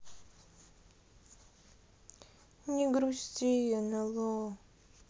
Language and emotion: Russian, sad